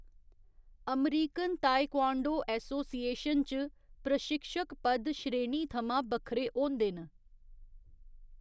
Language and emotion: Dogri, neutral